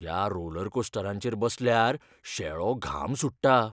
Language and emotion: Goan Konkani, fearful